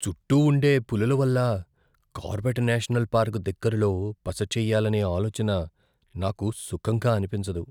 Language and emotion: Telugu, fearful